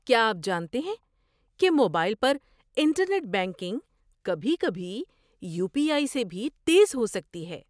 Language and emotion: Urdu, surprised